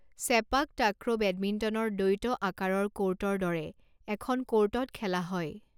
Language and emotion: Assamese, neutral